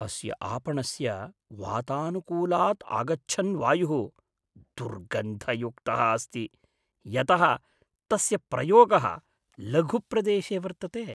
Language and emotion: Sanskrit, disgusted